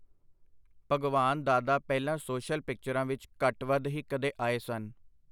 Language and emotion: Punjabi, neutral